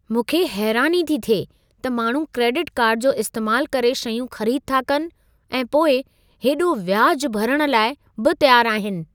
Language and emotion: Sindhi, surprised